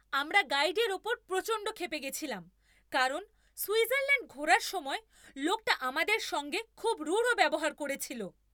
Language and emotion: Bengali, angry